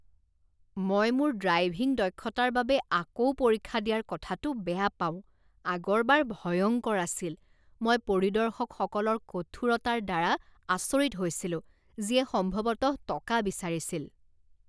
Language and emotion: Assamese, disgusted